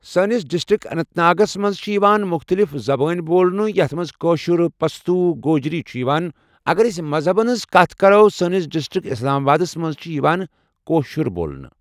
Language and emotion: Kashmiri, neutral